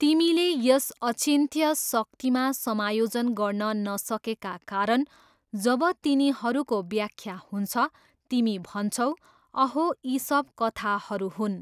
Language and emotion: Nepali, neutral